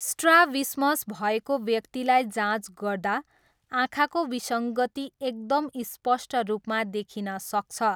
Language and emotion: Nepali, neutral